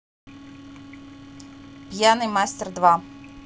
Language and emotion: Russian, neutral